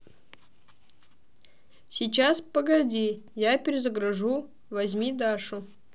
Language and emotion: Russian, neutral